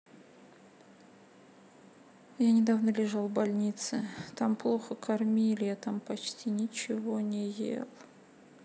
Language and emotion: Russian, sad